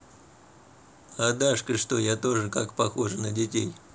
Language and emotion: Russian, neutral